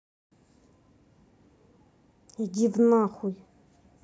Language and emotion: Russian, angry